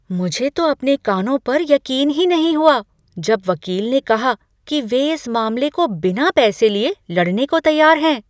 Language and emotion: Hindi, surprised